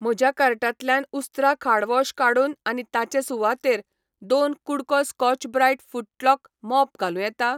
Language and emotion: Goan Konkani, neutral